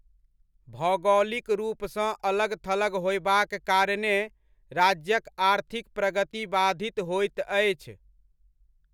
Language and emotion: Maithili, neutral